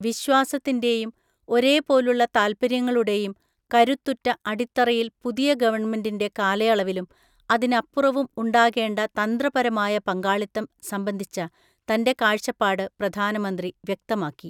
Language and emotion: Malayalam, neutral